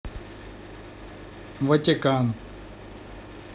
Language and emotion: Russian, neutral